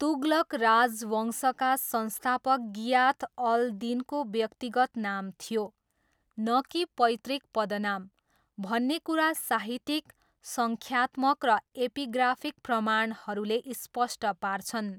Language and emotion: Nepali, neutral